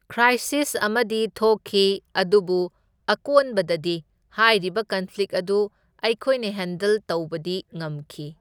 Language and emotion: Manipuri, neutral